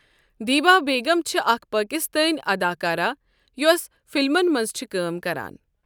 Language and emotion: Kashmiri, neutral